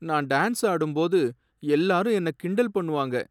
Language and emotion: Tamil, sad